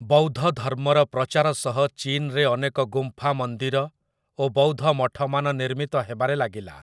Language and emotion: Odia, neutral